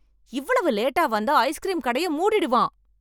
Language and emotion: Tamil, angry